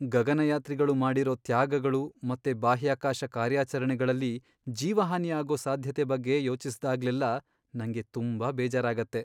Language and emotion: Kannada, sad